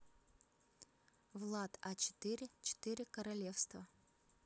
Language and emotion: Russian, neutral